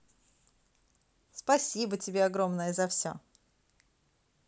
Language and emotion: Russian, positive